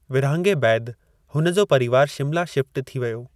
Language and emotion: Sindhi, neutral